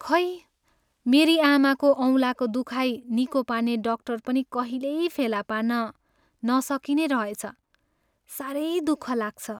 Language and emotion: Nepali, sad